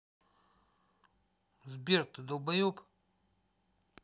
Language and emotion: Russian, angry